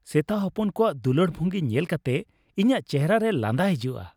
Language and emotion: Santali, happy